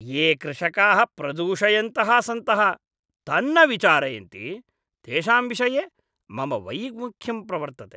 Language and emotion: Sanskrit, disgusted